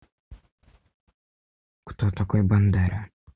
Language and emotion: Russian, neutral